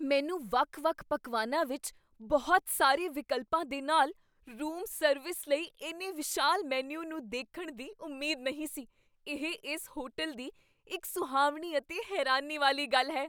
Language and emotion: Punjabi, surprised